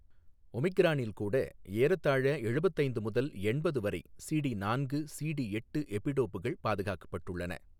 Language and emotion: Tamil, neutral